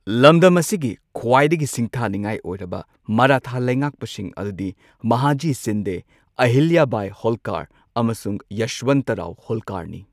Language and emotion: Manipuri, neutral